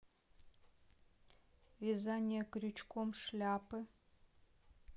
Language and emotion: Russian, neutral